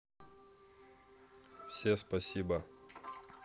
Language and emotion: Russian, neutral